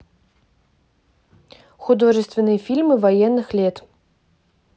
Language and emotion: Russian, neutral